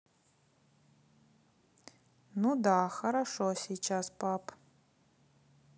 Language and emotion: Russian, neutral